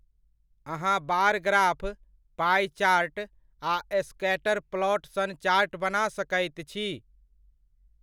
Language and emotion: Maithili, neutral